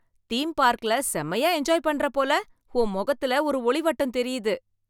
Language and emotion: Tamil, happy